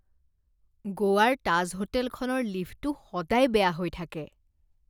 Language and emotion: Assamese, disgusted